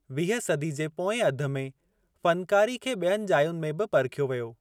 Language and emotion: Sindhi, neutral